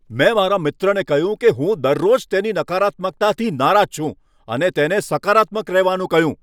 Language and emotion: Gujarati, angry